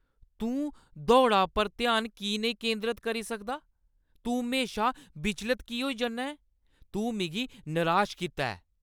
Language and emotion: Dogri, angry